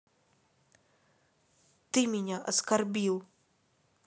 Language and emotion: Russian, angry